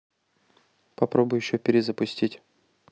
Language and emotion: Russian, neutral